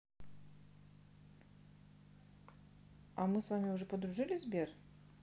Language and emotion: Russian, neutral